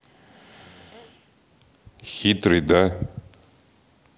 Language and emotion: Russian, neutral